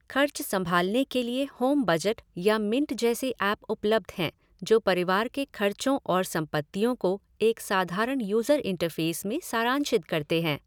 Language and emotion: Hindi, neutral